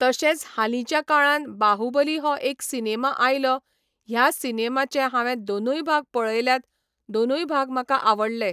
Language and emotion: Goan Konkani, neutral